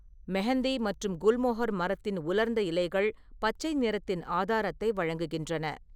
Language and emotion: Tamil, neutral